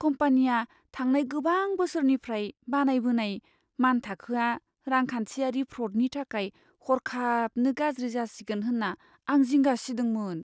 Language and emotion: Bodo, fearful